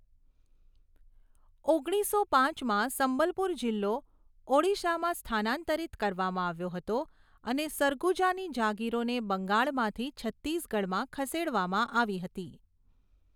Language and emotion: Gujarati, neutral